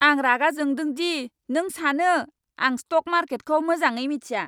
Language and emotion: Bodo, angry